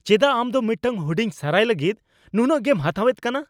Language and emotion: Santali, angry